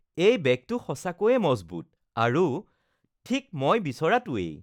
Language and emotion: Assamese, happy